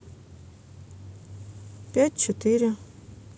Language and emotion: Russian, neutral